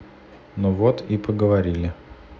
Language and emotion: Russian, neutral